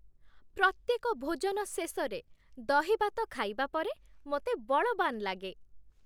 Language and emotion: Odia, happy